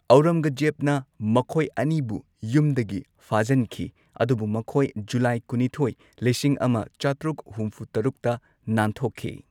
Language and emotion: Manipuri, neutral